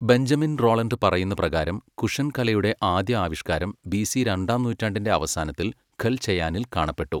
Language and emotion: Malayalam, neutral